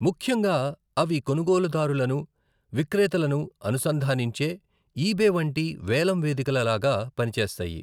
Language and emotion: Telugu, neutral